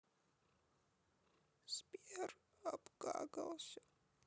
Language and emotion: Russian, sad